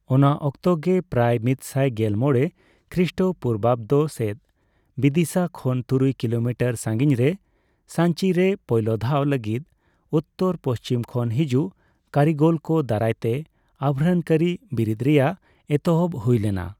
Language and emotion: Santali, neutral